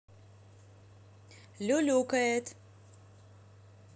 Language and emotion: Russian, positive